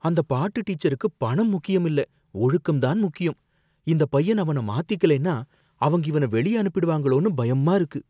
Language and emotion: Tamil, fearful